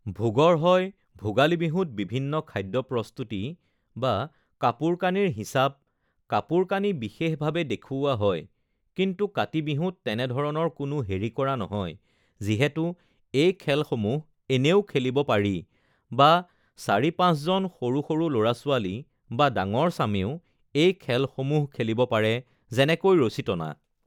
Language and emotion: Assamese, neutral